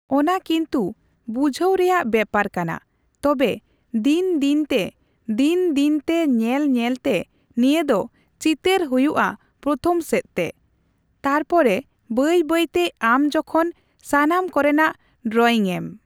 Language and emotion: Santali, neutral